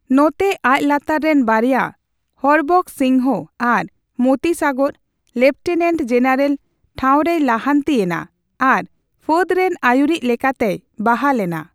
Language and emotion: Santali, neutral